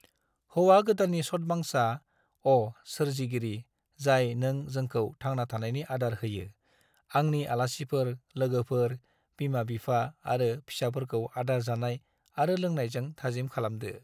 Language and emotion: Bodo, neutral